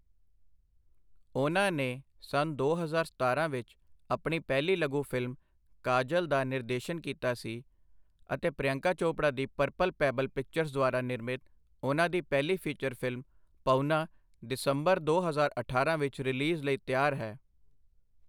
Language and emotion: Punjabi, neutral